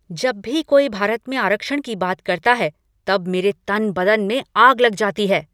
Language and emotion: Hindi, angry